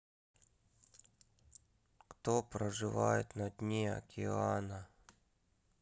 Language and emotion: Russian, sad